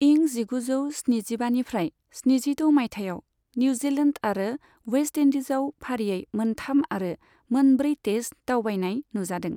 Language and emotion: Bodo, neutral